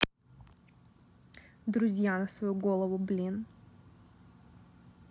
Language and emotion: Russian, angry